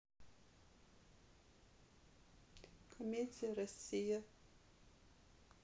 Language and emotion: Russian, neutral